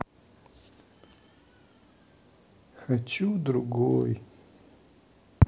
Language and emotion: Russian, sad